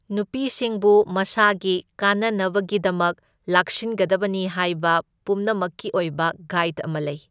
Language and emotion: Manipuri, neutral